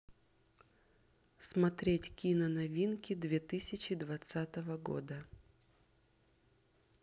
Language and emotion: Russian, neutral